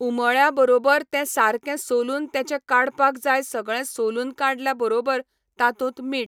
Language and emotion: Goan Konkani, neutral